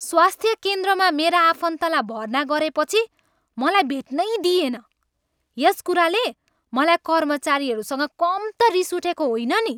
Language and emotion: Nepali, angry